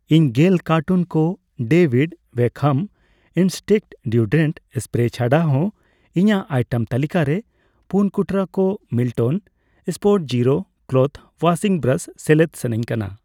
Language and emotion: Santali, neutral